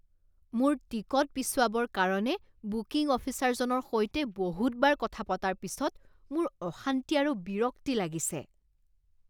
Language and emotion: Assamese, disgusted